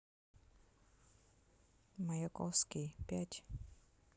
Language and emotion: Russian, neutral